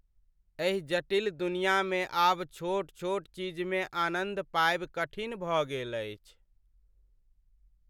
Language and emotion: Maithili, sad